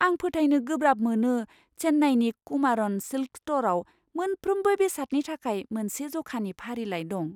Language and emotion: Bodo, surprised